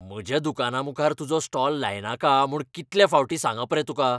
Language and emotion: Goan Konkani, angry